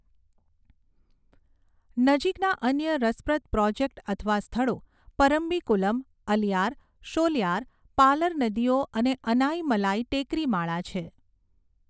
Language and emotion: Gujarati, neutral